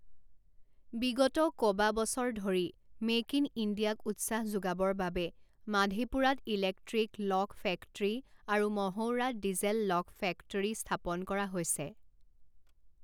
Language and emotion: Assamese, neutral